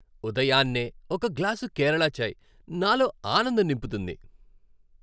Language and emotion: Telugu, happy